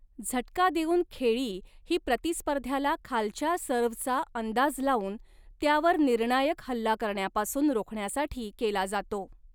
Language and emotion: Marathi, neutral